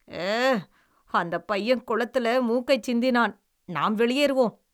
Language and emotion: Tamil, disgusted